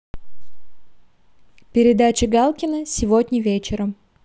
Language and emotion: Russian, neutral